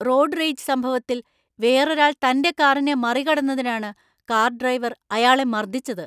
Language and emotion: Malayalam, angry